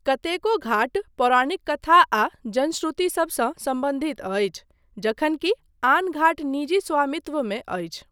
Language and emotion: Maithili, neutral